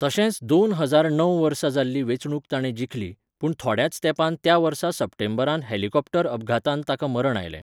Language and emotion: Goan Konkani, neutral